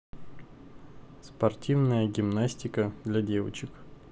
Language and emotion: Russian, neutral